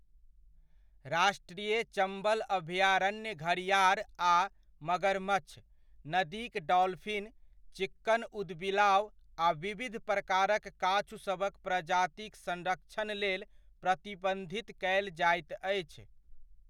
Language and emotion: Maithili, neutral